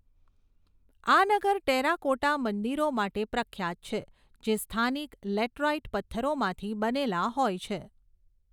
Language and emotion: Gujarati, neutral